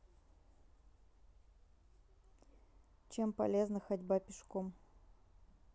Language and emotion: Russian, neutral